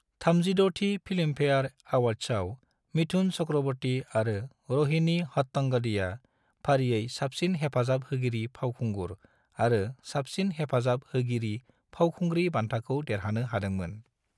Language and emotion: Bodo, neutral